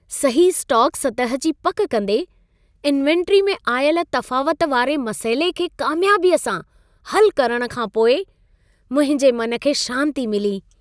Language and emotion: Sindhi, happy